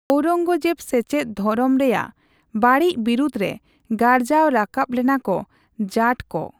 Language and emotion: Santali, neutral